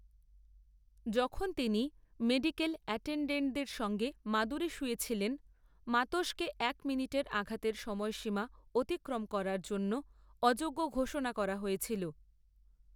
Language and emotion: Bengali, neutral